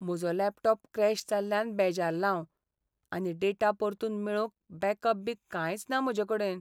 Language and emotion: Goan Konkani, sad